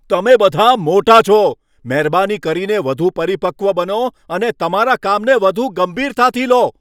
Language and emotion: Gujarati, angry